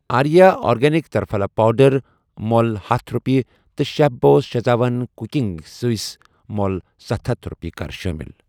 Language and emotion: Kashmiri, neutral